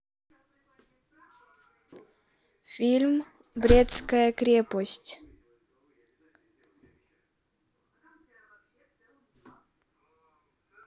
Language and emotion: Russian, neutral